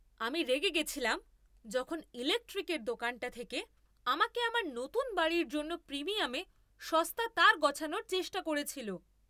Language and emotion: Bengali, angry